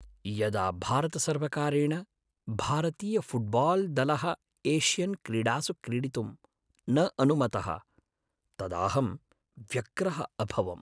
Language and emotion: Sanskrit, sad